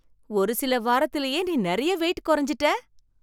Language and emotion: Tamil, surprised